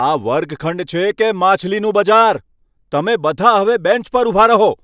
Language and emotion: Gujarati, angry